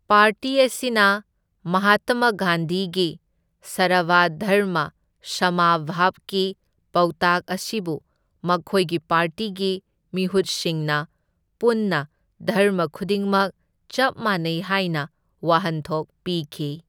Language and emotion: Manipuri, neutral